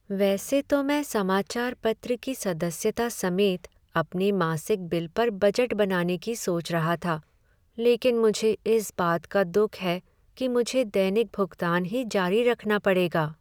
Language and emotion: Hindi, sad